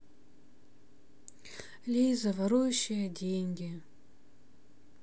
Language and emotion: Russian, sad